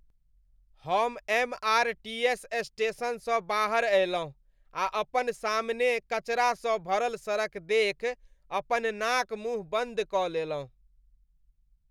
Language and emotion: Maithili, disgusted